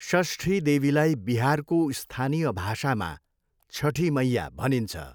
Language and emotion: Nepali, neutral